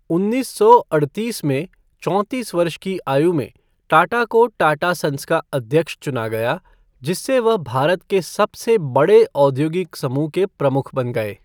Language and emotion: Hindi, neutral